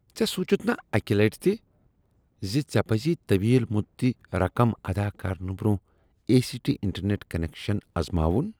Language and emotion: Kashmiri, disgusted